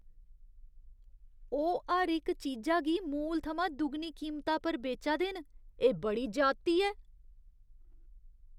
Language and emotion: Dogri, disgusted